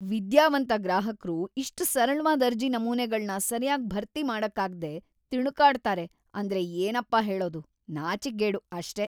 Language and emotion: Kannada, disgusted